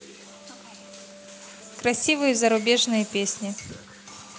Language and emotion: Russian, neutral